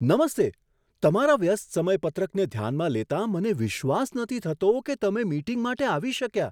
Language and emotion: Gujarati, surprised